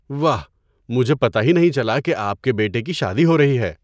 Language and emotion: Urdu, surprised